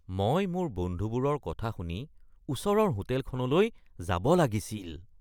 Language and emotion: Assamese, disgusted